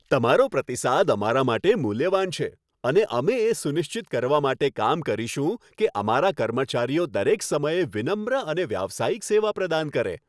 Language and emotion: Gujarati, happy